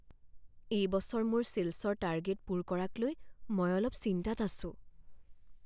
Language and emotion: Assamese, fearful